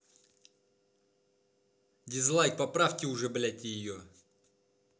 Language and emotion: Russian, angry